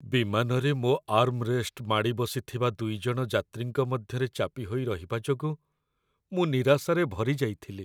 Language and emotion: Odia, sad